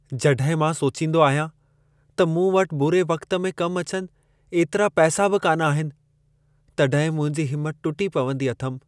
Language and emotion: Sindhi, sad